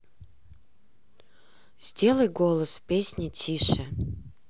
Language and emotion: Russian, neutral